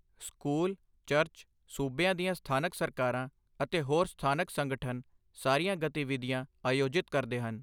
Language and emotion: Punjabi, neutral